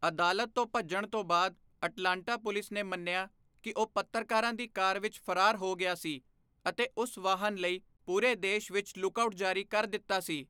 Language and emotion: Punjabi, neutral